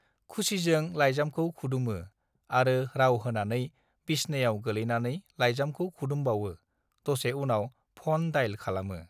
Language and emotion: Bodo, neutral